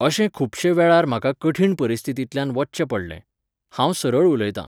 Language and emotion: Goan Konkani, neutral